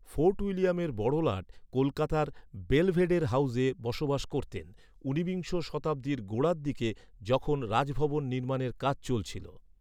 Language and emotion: Bengali, neutral